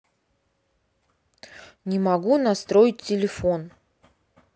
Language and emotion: Russian, neutral